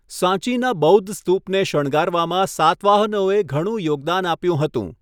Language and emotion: Gujarati, neutral